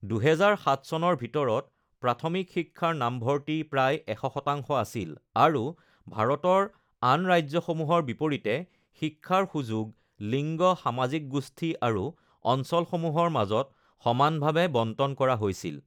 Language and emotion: Assamese, neutral